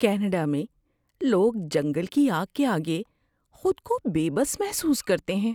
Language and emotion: Urdu, fearful